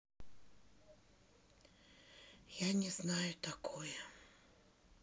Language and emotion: Russian, sad